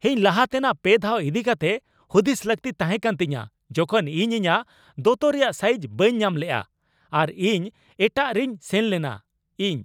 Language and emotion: Santali, angry